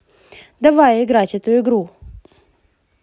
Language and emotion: Russian, positive